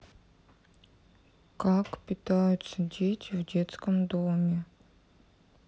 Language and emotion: Russian, sad